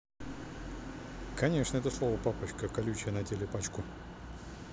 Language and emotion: Russian, neutral